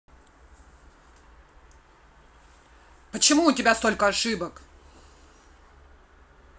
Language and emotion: Russian, angry